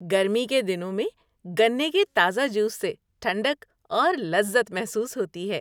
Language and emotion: Urdu, happy